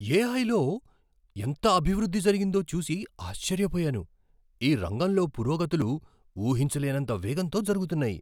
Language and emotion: Telugu, surprised